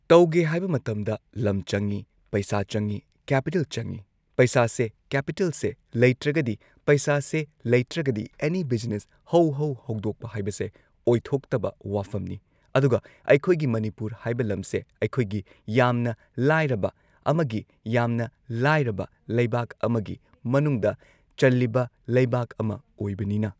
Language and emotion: Manipuri, neutral